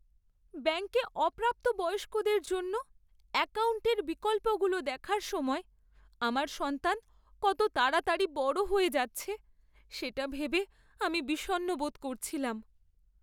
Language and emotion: Bengali, sad